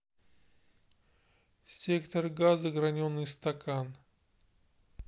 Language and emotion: Russian, neutral